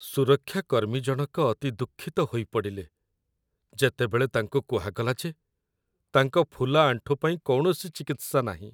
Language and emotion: Odia, sad